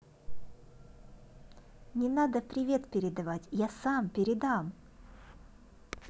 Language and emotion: Russian, positive